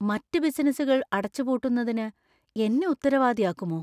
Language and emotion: Malayalam, fearful